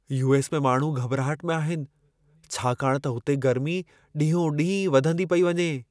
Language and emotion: Sindhi, fearful